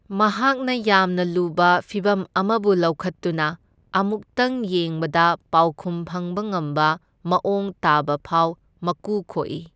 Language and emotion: Manipuri, neutral